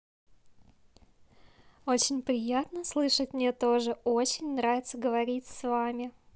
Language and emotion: Russian, positive